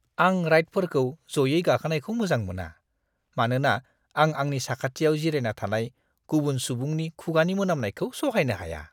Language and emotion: Bodo, disgusted